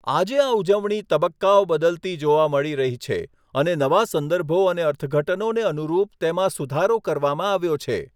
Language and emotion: Gujarati, neutral